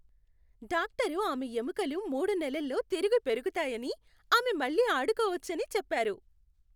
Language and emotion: Telugu, happy